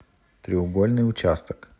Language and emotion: Russian, neutral